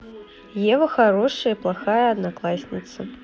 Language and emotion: Russian, neutral